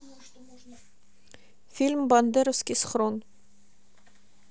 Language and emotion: Russian, neutral